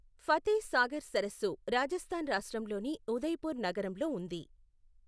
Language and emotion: Telugu, neutral